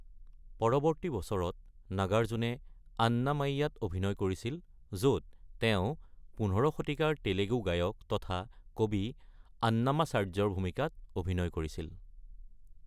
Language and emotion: Assamese, neutral